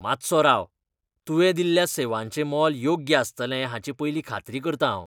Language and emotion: Goan Konkani, disgusted